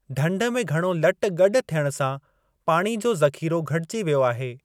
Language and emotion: Sindhi, neutral